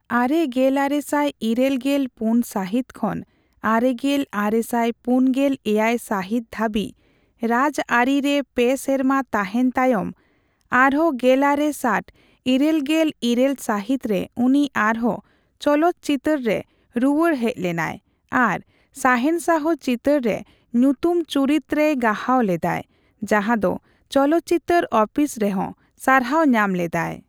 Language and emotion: Santali, neutral